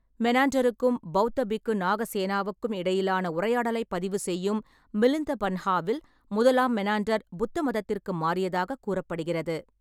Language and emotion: Tamil, neutral